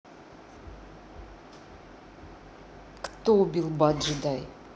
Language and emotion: Russian, neutral